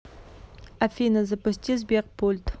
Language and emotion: Russian, neutral